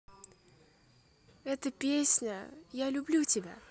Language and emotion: Russian, positive